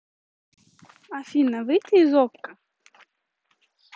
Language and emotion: Russian, neutral